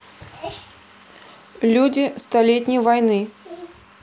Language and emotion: Russian, neutral